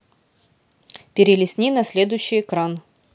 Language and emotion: Russian, neutral